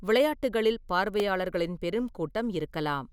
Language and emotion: Tamil, neutral